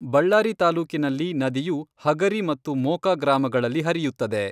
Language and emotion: Kannada, neutral